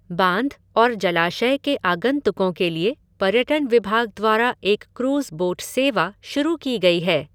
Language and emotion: Hindi, neutral